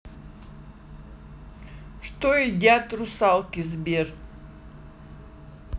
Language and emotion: Russian, neutral